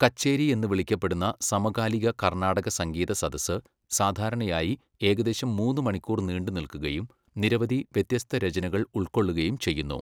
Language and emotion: Malayalam, neutral